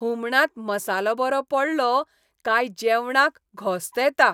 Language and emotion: Goan Konkani, happy